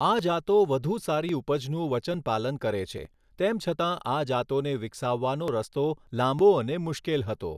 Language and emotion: Gujarati, neutral